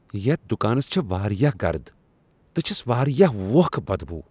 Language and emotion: Kashmiri, disgusted